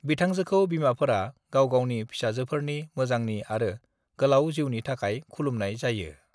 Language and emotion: Bodo, neutral